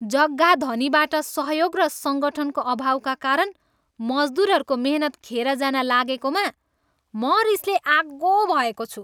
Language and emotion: Nepali, angry